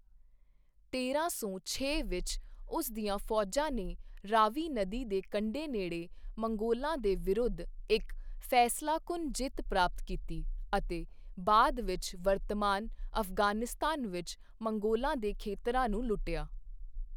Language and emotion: Punjabi, neutral